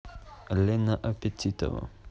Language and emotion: Russian, neutral